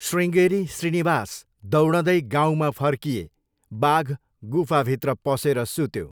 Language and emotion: Nepali, neutral